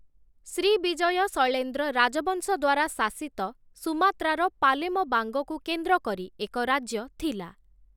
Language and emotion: Odia, neutral